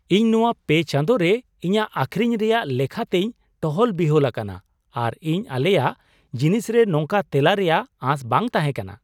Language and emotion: Santali, surprised